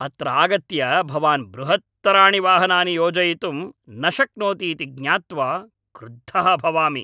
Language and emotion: Sanskrit, angry